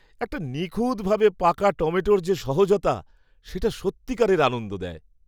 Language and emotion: Bengali, happy